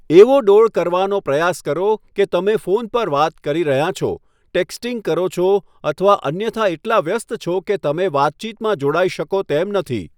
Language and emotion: Gujarati, neutral